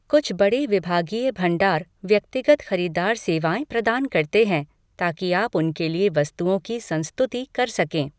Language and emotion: Hindi, neutral